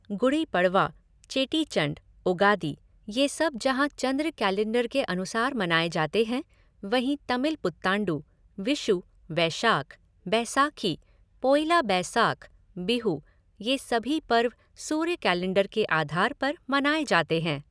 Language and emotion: Hindi, neutral